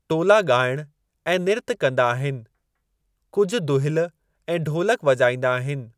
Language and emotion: Sindhi, neutral